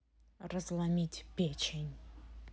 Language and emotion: Russian, angry